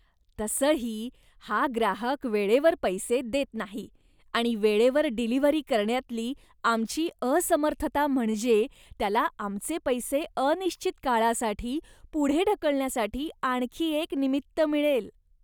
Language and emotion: Marathi, disgusted